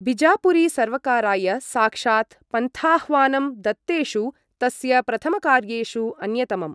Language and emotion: Sanskrit, neutral